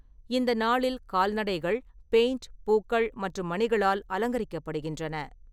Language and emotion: Tamil, neutral